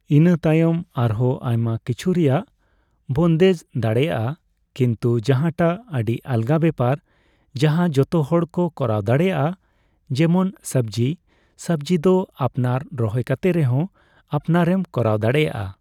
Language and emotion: Santali, neutral